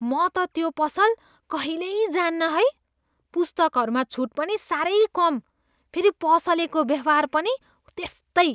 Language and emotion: Nepali, disgusted